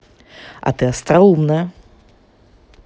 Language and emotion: Russian, positive